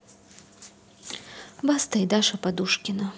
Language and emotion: Russian, neutral